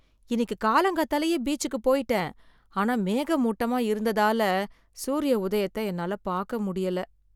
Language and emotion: Tamil, sad